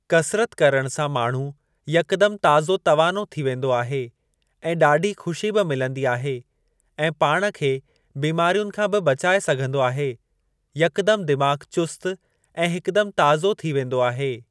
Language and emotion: Sindhi, neutral